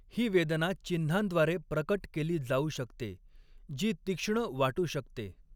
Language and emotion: Marathi, neutral